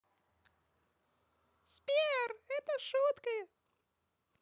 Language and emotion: Russian, positive